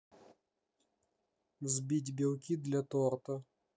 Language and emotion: Russian, neutral